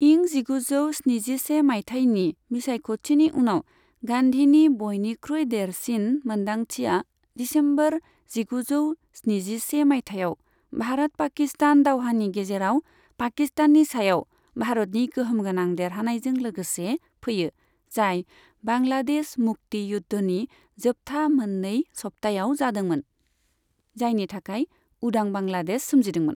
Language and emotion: Bodo, neutral